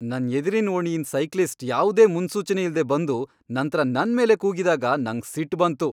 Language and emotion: Kannada, angry